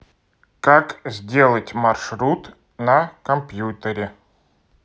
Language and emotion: Russian, neutral